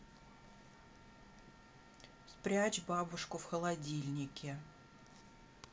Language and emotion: Russian, neutral